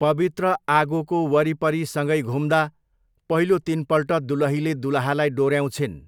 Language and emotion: Nepali, neutral